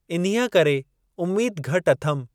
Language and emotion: Sindhi, neutral